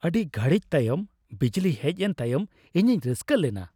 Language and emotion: Santali, happy